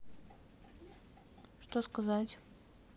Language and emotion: Russian, neutral